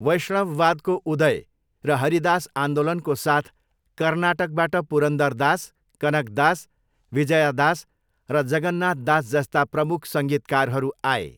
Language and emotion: Nepali, neutral